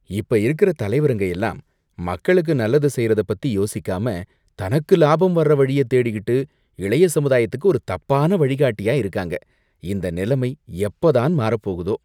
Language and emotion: Tamil, disgusted